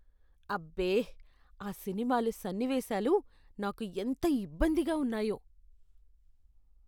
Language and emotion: Telugu, disgusted